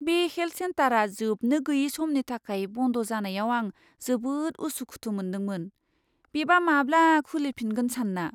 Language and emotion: Bodo, fearful